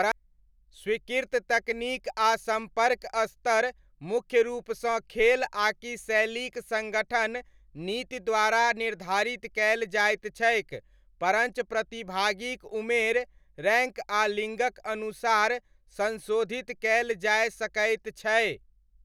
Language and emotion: Maithili, neutral